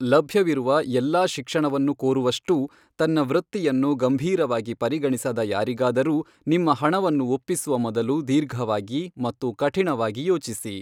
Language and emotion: Kannada, neutral